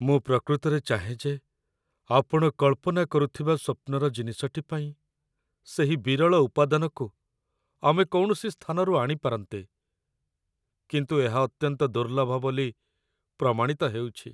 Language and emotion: Odia, sad